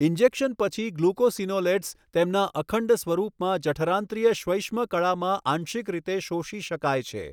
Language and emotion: Gujarati, neutral